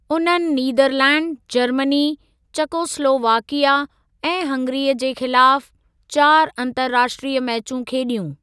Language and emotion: Sindhi, neutral